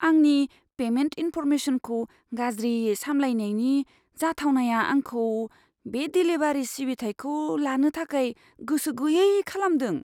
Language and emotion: Bodo, fearful